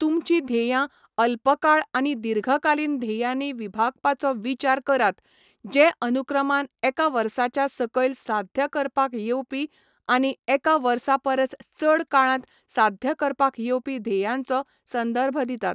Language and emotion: Goan Konkani, neutral